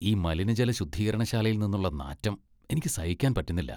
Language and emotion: Malayalam, disgusted